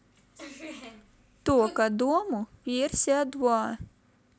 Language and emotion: Russian, neutral